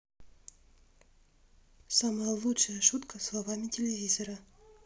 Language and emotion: Russian, neutral